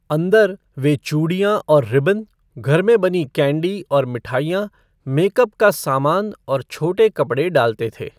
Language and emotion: Hindi, neutral